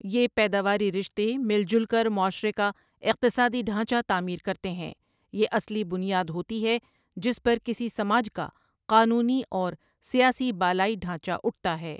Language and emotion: Urdu, neutral